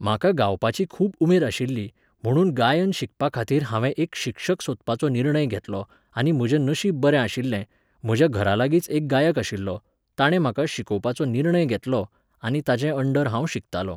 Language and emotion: Goan Konkani, neutral